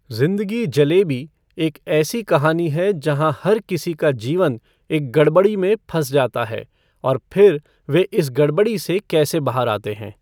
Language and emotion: Hindi, neutral